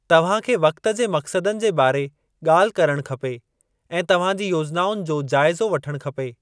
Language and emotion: Sindhi, neutral